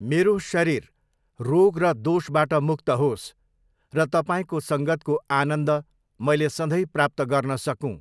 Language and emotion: Nepali, neutral